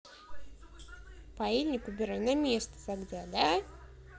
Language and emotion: Russian, neutral